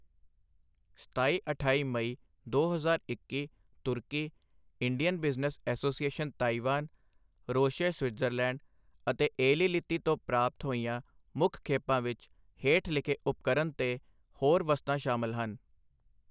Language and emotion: Punjabi, neutral